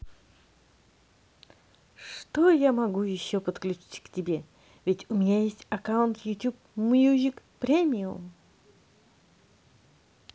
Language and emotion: Russian, positive